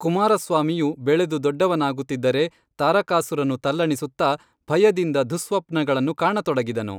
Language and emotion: Kannada, neutral